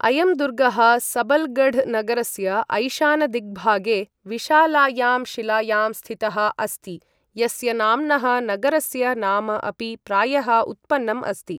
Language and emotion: Sanskrit, neutral